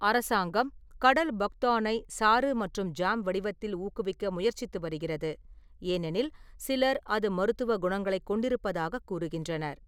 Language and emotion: Tamil, neutral